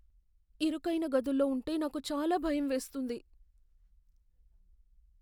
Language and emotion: Telugu, fearful